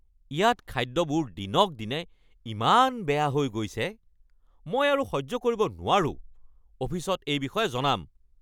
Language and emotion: Assamese, angry